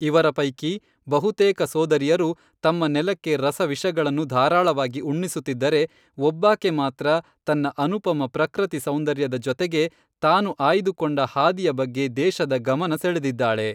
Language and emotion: Kannada, neutral